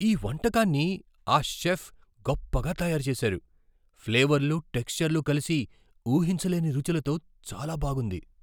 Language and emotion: Telugu, surprised